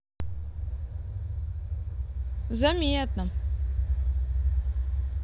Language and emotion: Russian, neutral